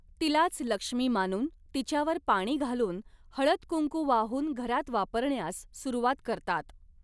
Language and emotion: Marathi, neutral